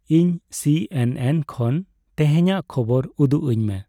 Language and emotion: Santali, neutral